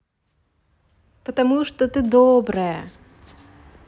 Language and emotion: Russian, positive